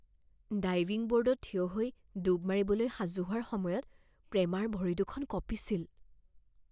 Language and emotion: Assamese, fearful